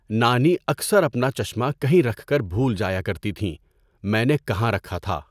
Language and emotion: Urdu, neutral